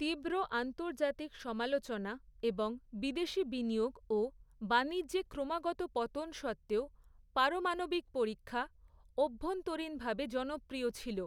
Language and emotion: Bengali, neutral